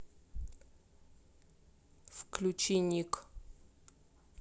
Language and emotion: Russian, neutral